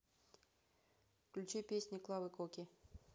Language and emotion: Russian, neutral